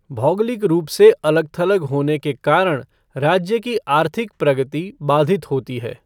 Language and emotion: Hindi, neutral